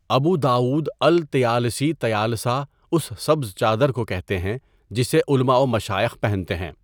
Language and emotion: Urdu, neutral